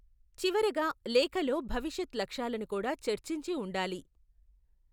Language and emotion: Telugu, neutral